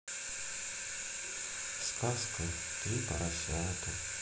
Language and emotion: Russian, sad